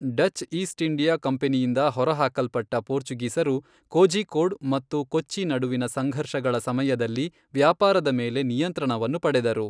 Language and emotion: Kannada, neutral